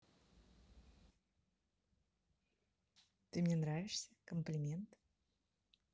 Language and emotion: Russian, positive